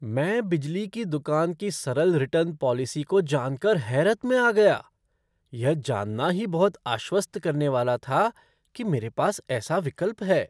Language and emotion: Hindi, surprised